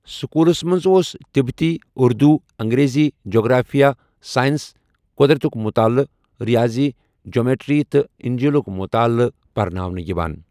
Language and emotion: Kashmiri, neutral